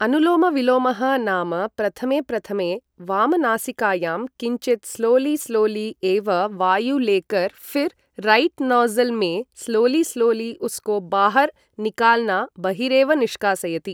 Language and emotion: Sanskrit, neutral